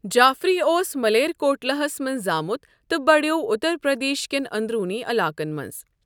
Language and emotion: Kashmiri, neutral